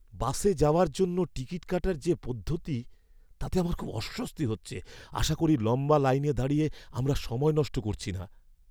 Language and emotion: Bengali, fearful